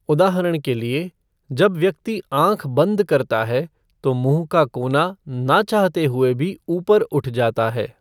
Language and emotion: Hindi, neutral